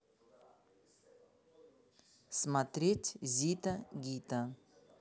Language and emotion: Russian, neutral